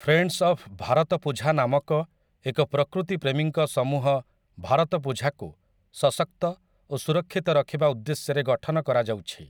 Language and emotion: Odia, neutral